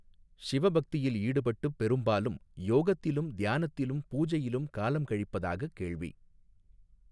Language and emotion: Tamil, neutral